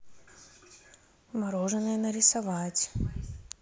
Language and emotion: Russian, neutral